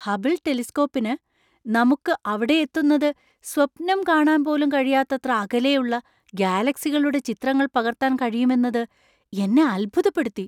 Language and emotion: Malayalam, surprised